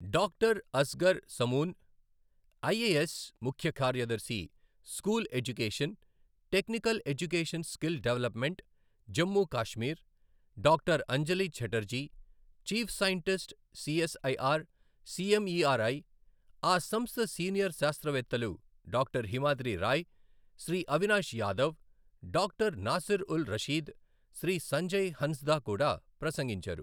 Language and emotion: Telugu, neutral